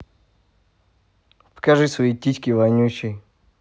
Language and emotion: Russian, neutral